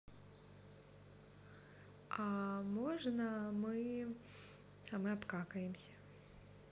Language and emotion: Russian, neutral